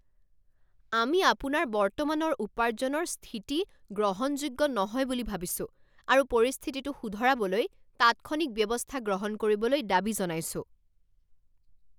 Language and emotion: Assamese, angry